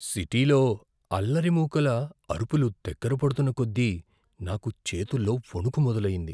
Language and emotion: Telugu, fearful